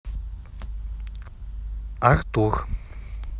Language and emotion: Russian, neutral